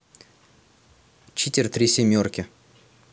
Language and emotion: Russian, neutral